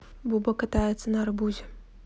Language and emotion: Russian, neutral